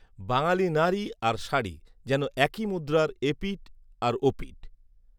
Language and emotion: Bengali, neutral